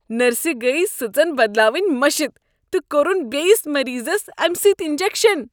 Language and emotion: Kashmiri, disgusted